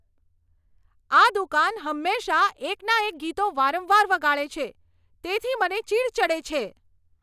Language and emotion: Gujarati, angry